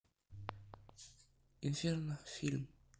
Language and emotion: Russian, neutral